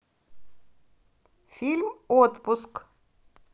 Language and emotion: Russian, neutral